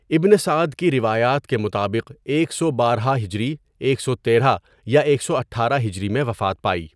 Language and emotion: Urdu, neutral